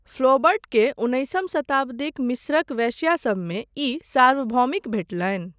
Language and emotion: Maithili, neutral